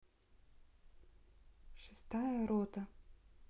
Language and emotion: Russian, neutral